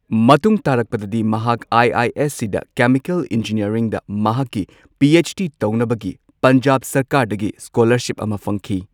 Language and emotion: Manipuri, neutral